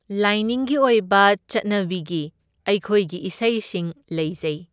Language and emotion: Manipuri, neutral